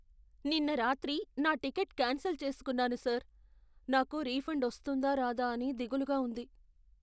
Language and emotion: Telugu, fearful